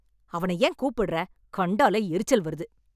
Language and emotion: Tamil, angry